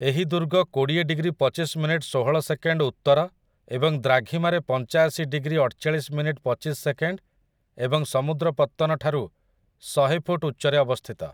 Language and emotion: Odia, neutral